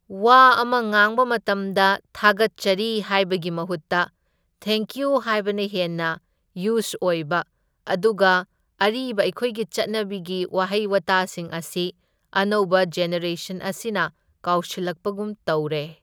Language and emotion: Manipuri, neutral